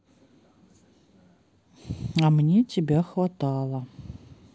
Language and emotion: Russian, sad